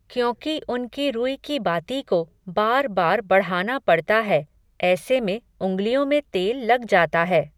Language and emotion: Hindi, neutral